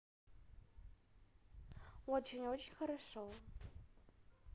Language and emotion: Russian, positive